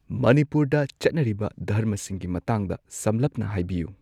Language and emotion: Manipuri, neutral